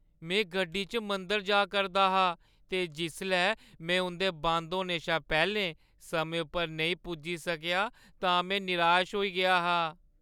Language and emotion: Dogri, sad